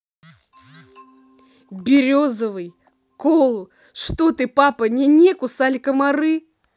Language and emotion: Russian, angry